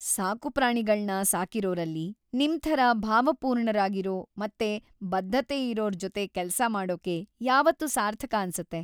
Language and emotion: Kannada, happy